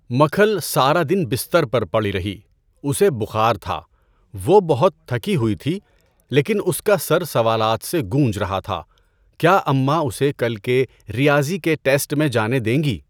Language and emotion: Urdu, neutral